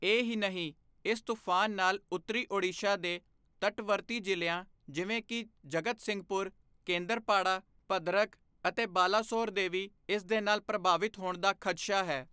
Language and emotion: Punjabi, neutral